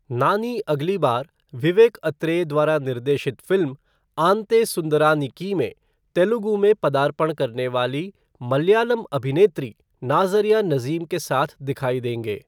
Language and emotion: Hindi, neutral